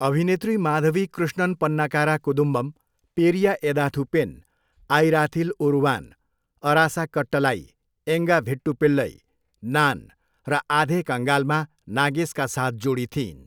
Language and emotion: Nepali, neutral